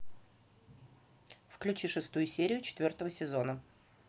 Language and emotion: Russian, neutral